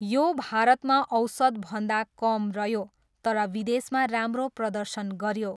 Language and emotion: Nepali, neutral